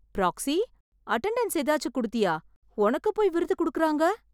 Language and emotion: Tamil, surprised